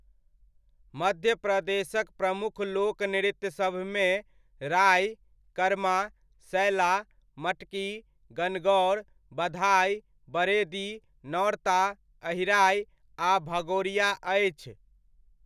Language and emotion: Maithili, neutral